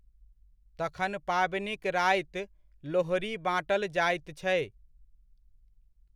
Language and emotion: Maithili, neutral